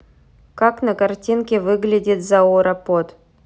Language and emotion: Russian, neutral